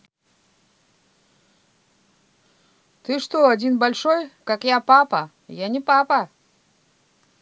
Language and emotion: Russian, neutral